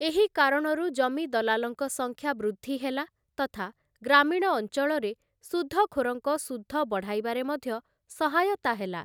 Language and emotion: Odia, neutral